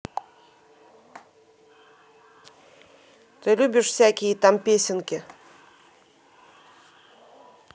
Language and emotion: Russian, angry